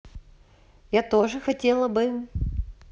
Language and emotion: Russian, neutral